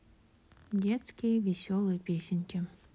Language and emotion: Russian, neutral